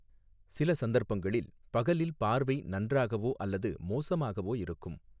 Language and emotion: Tamil, neutral